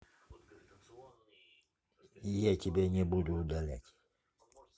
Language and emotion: Russian, neutral